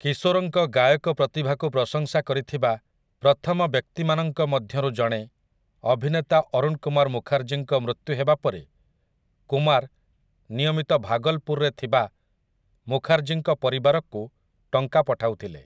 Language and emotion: Odia, neutral